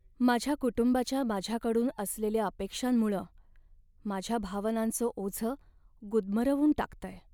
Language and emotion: Marathi, sad